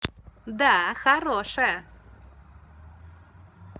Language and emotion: Russian, positive